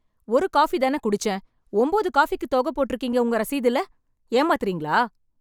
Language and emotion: Tamil, angry